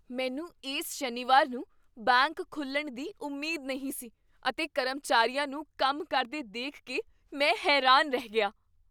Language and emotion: Punjabi, surprised